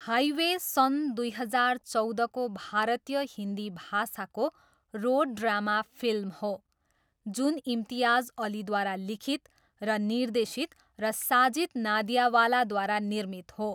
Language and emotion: Nepali, neutral